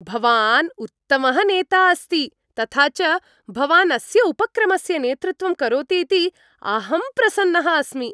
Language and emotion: Sanskrit, happy